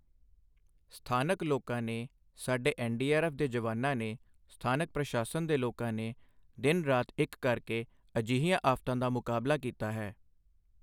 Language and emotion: Punjabi, neutral